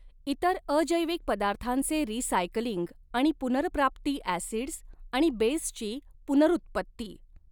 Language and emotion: Marathi, neutral